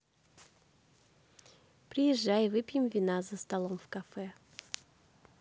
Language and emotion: Russian, neutral